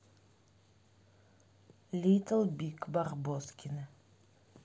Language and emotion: Russian, neutral